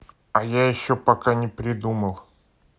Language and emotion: Russian, neutral